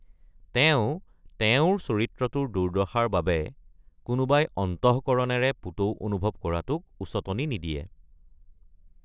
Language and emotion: Assamese, neutral